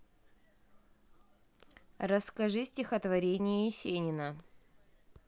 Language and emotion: Russian, neutral